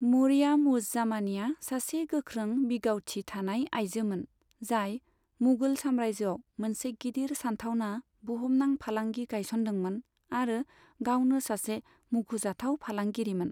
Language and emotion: Bodo, neutral